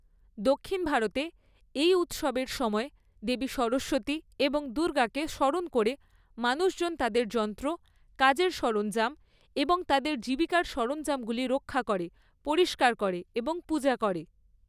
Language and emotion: Bengali, neutral